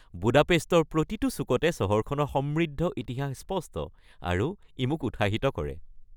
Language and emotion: Assamese, happy